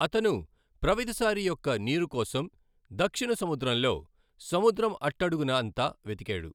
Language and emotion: Telugu, neutral